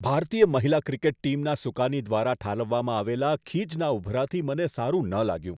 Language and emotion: Gujarati, disgusted